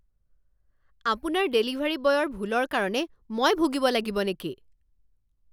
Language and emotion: Assamese, angry